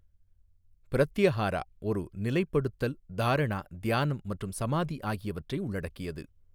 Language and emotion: Tamil, neutral